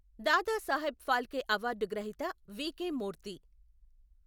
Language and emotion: Telugu, neutral